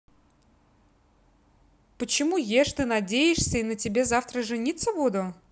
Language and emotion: Russian, neutral